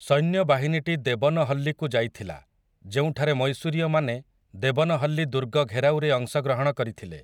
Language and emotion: Odia, neutral